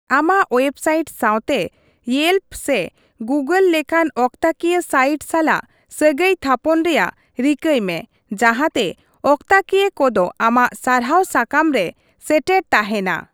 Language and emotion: Santali, neutral